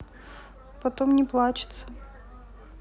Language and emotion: Russian, sad